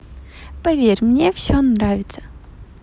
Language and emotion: Russian, positive